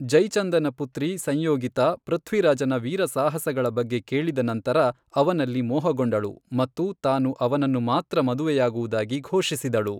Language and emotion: Kannada, neutral